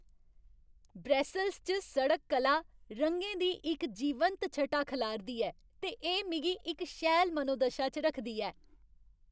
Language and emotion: Dogri, happy